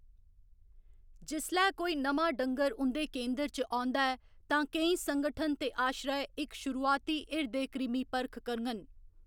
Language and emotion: Dogri, neutral